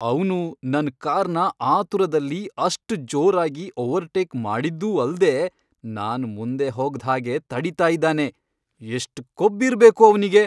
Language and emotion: Kannada, angry